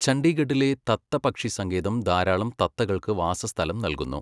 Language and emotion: Malayalam, neutral